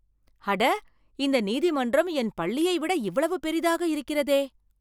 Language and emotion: Tamil, surprised